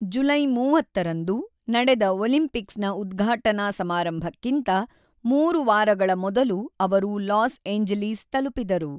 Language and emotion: Kannada, neutral